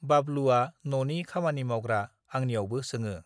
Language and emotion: Bodo, neutral